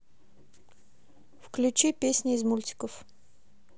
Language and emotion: Russian, neutral